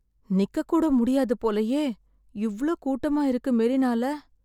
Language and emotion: Tamil, sad